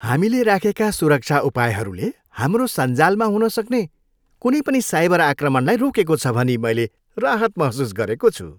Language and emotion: Nepali, happy